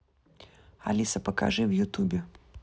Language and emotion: Russian, neutral